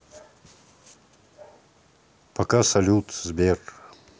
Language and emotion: Russian, neutral